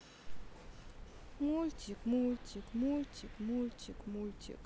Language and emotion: Russian, sad